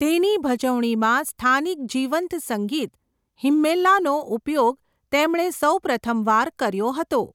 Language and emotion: Gujarati, neutral